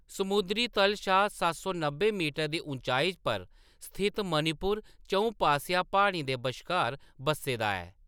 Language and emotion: Dogri, neutral